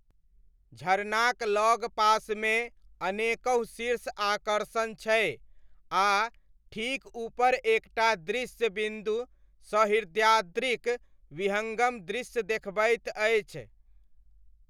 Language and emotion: Maithili, neutral